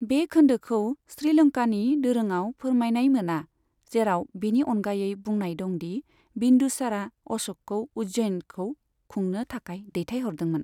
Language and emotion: Bodo, neutral